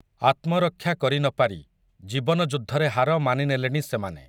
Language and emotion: Odia, neutral